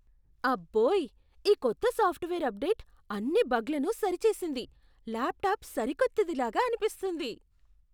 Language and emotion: Telugu, surprised